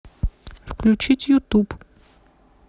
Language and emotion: Russian, neutral